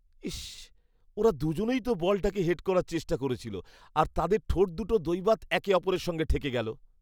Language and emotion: Bengali, disgusted